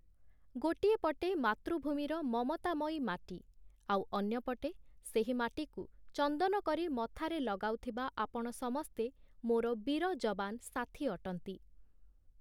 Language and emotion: Odia, neutral